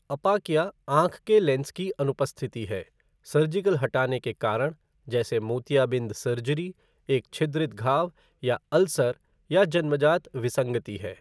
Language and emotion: Hindi, neutral